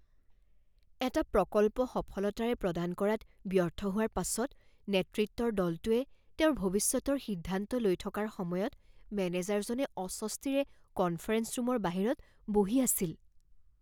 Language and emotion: Assamese, fearful